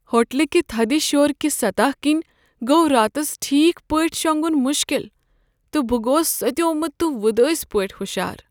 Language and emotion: Kashmiri, sad